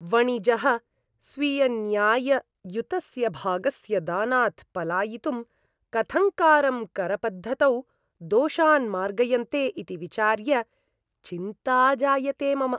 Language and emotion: Sanskrit, disgusted